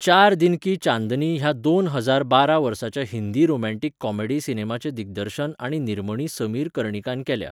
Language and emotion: Goan Konkani, neutral